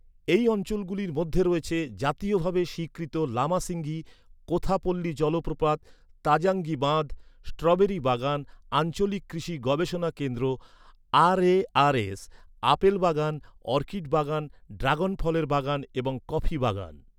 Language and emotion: Bengali, neutral